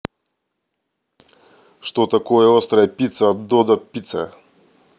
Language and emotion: Russian, neutral